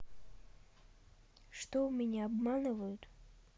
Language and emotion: Russian, sad